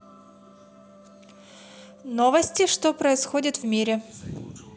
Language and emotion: Russian, positive